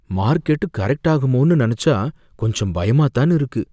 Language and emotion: Tamil, fearful